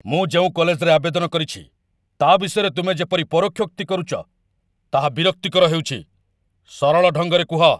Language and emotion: Odia, angry